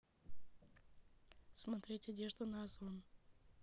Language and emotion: Russian, neutral